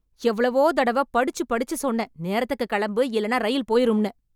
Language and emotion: Tamil, angry